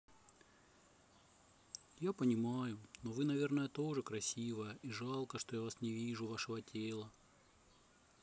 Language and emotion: Russian, sad